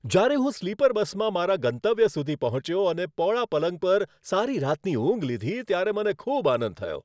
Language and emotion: Gujarati, happy